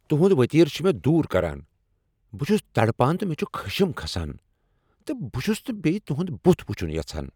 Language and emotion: Kashmiri, angry